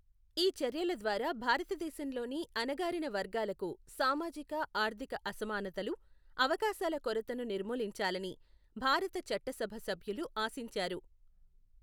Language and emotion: Telugu, neutral